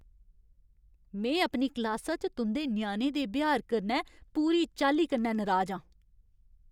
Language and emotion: Dogri, angry